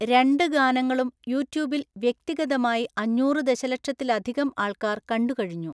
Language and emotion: Malayalam, neutral